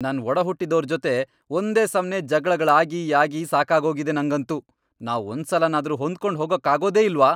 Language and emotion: Kannada, angry